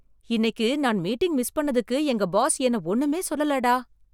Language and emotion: Tamil, surprised